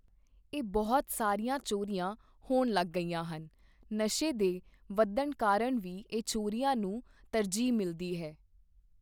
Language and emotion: Punjabi, neutral